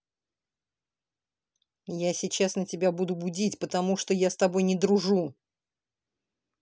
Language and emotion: Russian, angry